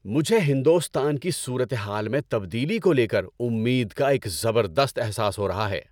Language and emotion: Urdu, happy